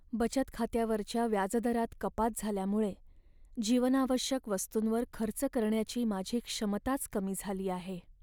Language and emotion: Marathi, sad